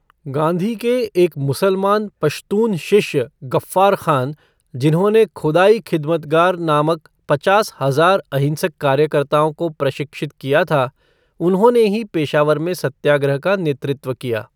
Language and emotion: Hindi, neutral